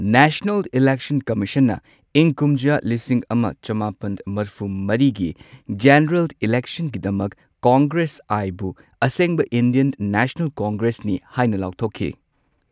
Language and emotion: Manipuri, neutral